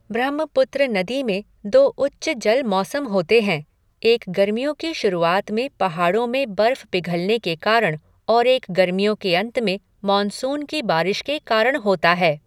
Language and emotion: Hindi, neutral